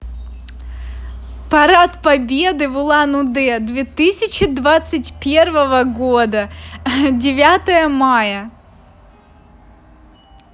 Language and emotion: Russian, positive